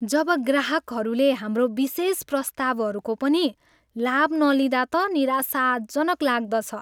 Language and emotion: Nepali, sad